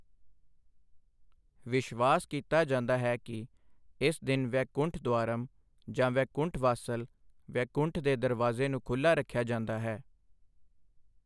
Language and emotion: Punjabi, neutral